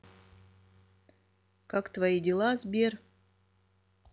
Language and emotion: Russian, neutral